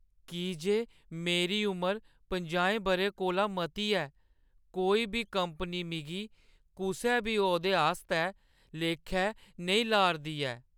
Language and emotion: Dogri, sad